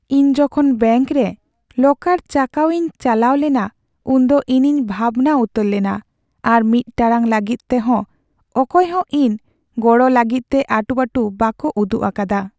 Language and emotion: Santali, sad